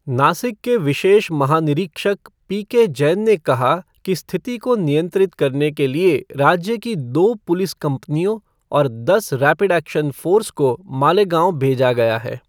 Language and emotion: Hindi, neutral